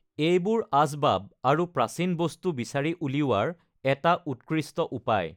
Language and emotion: Assamese, neutral